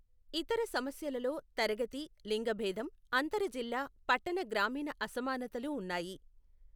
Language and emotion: Telugu, neutral